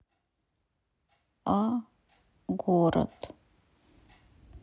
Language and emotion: Russian, sad